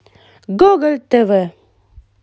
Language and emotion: Russian, positive